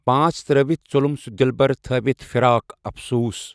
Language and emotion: Kashmiri, neutral